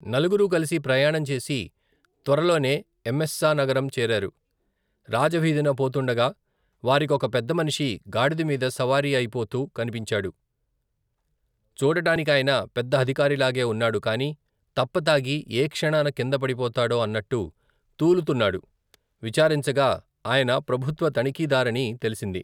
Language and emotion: Telugu, neutral